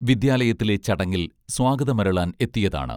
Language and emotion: Malayalam, neutral